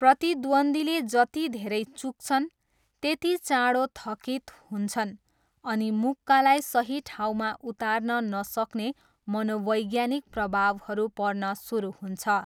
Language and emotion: Nepali, neutral